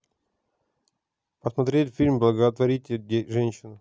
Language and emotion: Russian, neutral